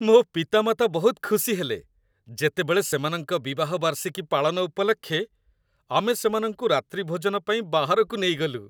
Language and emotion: Odia, happy